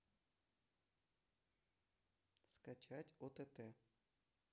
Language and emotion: Russian, neutral